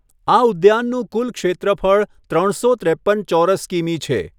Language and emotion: Gujarati, neutral